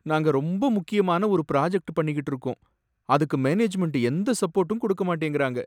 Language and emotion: Tamil, sad